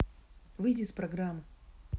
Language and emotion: Russian, angry